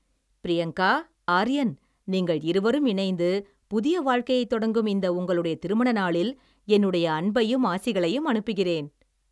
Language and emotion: Tamil, happy